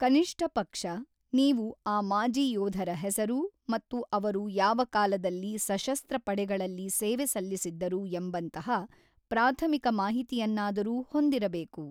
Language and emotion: Kannada, neutral